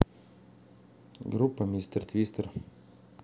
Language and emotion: Russian, neutral